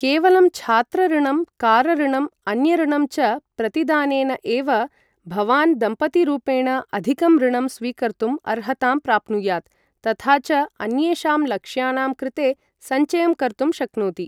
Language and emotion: Sanskrit, neutral